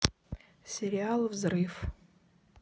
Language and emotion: Russian, neutral